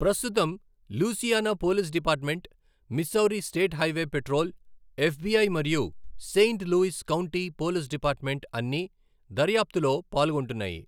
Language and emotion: Telugu, neutral